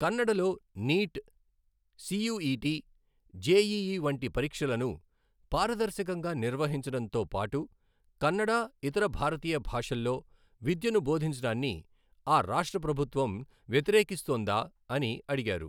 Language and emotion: Telugu, neutral